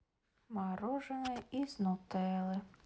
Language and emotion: Russian, sad